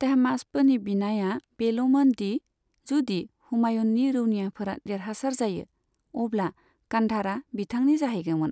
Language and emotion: Bodo, neutral